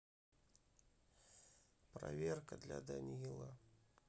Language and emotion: Russian, sad